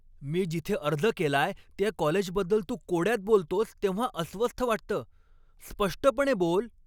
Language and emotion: Marathi, angry